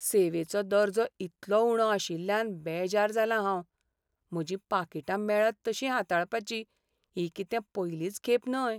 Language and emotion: Goan Konkani, sad